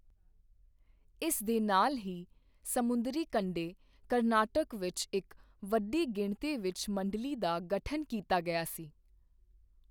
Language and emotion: Punjabi, neutral